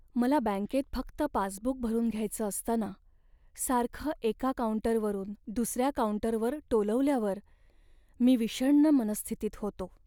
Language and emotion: Marathi, sad